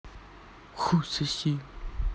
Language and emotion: Russian, angry